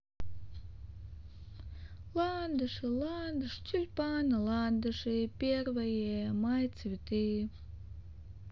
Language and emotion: Russian, positive